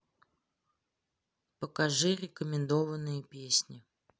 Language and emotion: Russian, neutral